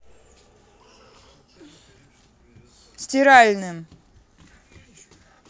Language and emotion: Russian, angry